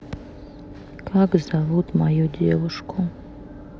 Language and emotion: Russian, neutral